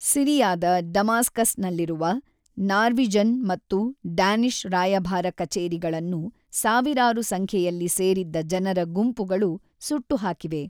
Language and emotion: Kannada, neutral